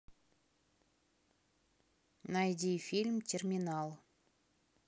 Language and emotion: Russian, neutral